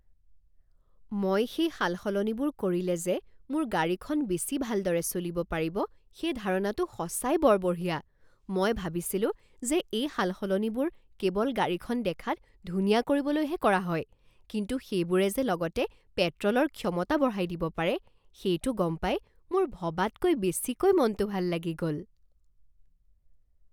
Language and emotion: Assamese, surprised